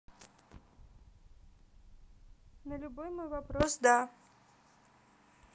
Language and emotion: Russian, neutral